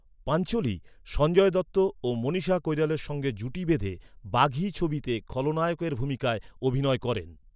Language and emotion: Bengali, neutral